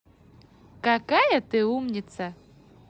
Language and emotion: Russian, positive